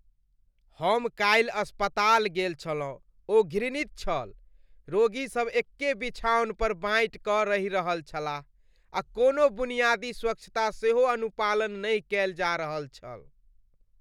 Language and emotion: Maithili, disgusted